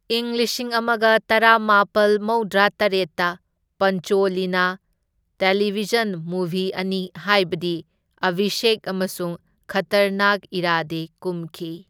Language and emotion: Manipuri, neutral